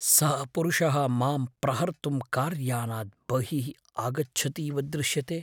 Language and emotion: Sanskrit, fearful